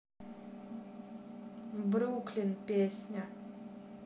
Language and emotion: Russian, neutral